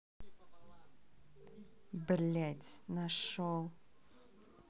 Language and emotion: Russian, angry